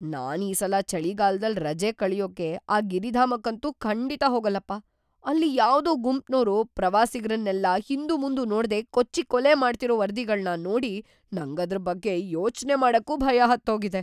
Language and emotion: Kannada, fearful